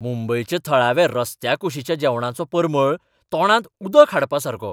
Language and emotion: Goan Konkani, surprised